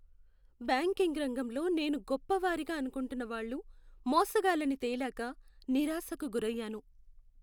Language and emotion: Telugu, sad